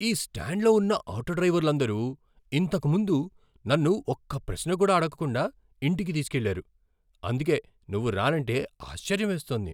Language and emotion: Telugu, surprised